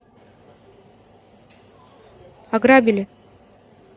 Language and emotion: Russian, neutral